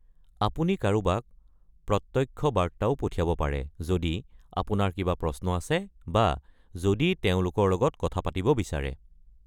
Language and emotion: Assamese, neutral